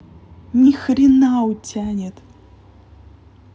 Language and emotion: Russian, angry